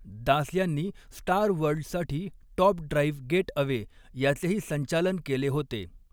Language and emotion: Marathi, neutral